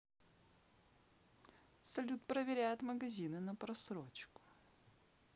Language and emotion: Russian, neutral